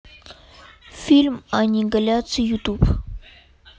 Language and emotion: Russian, neutral